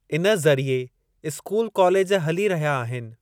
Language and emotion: Sindhi, neutral